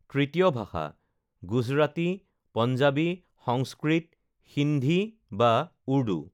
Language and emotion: Assamese, neutral